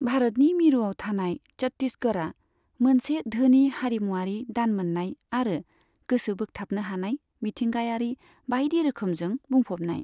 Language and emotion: Bodo, neutral